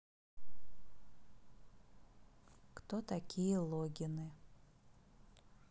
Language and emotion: Russian, neutral